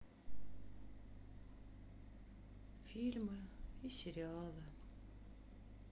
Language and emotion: Russian, sad